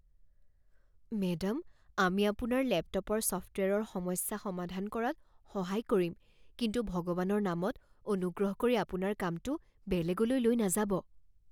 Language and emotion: Assamese, fearful